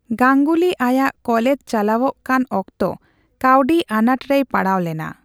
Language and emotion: Santali, neutral